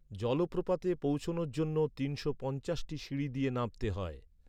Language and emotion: Bengali, neutral